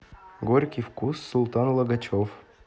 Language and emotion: Russian, neutral